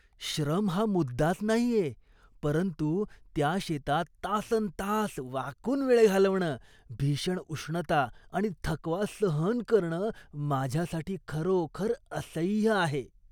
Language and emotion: Marathi, disgusted